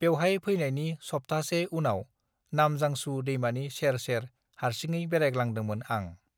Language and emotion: Bodo, neutral